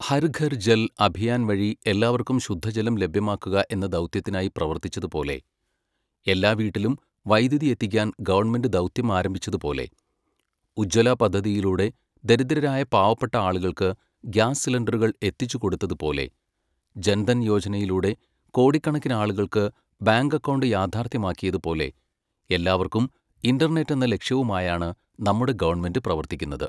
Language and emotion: Malayalam, neutral